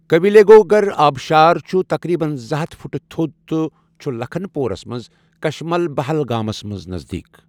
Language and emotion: Kashmiri, neutral